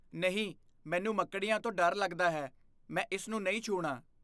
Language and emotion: Punjabi, fearful